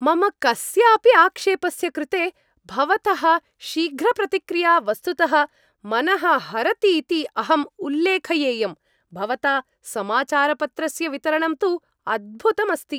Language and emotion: Sanskrit, happy